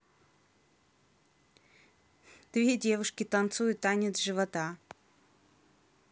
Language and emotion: Russian, neutral